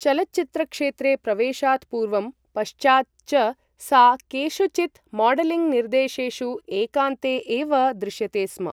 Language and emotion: Sanskrit, neutral